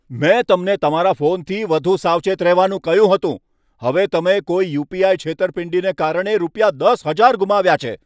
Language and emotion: Gujarati, angry